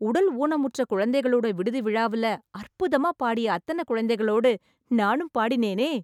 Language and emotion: Tamil, happy